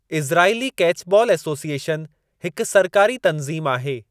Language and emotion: Sindhi, neutral